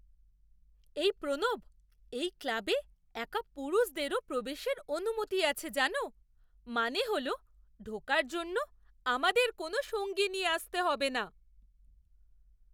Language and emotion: Bengali, surprised